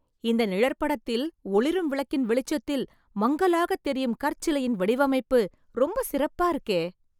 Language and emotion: Tamil, surprised